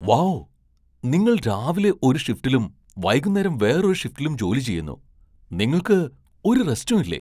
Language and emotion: Malayalam, surprised